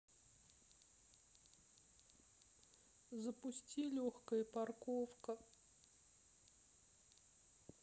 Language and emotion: Russian, sad